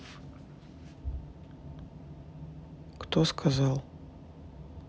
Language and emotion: Russian, neutral